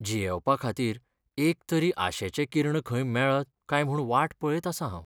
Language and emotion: Goan Konkani, sad